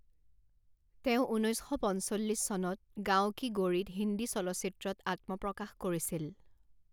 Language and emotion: Assamese, neutral